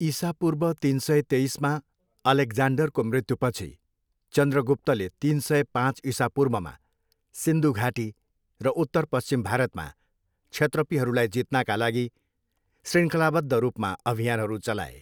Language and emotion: Nepali, neutral